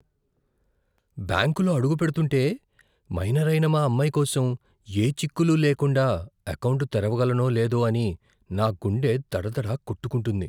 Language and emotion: Telugu, fearful